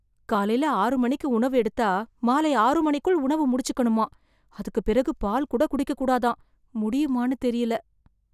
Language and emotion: Tamil, fearful